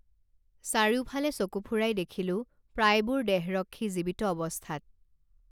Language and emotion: Assamese, neutral